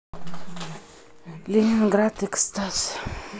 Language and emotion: Russian, sad